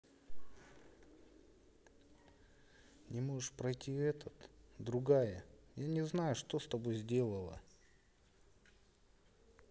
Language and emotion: Russian, sad